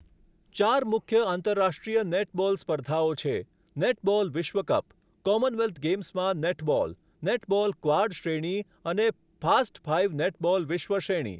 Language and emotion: Gujarati, neutral